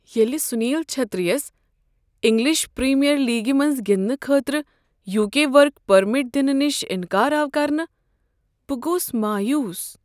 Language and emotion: Kashmiri, sad